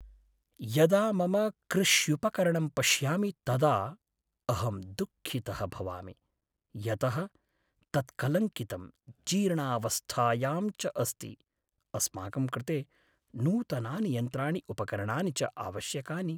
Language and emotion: Sanskrit, sad